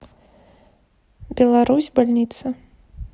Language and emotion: Russian, neutral